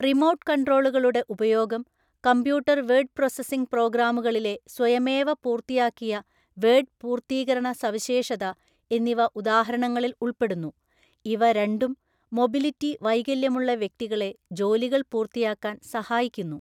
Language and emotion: Malayalam, neutral